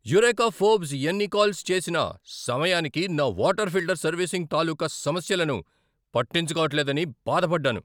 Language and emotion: Telugu, angry